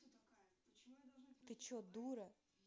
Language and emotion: Russian, angry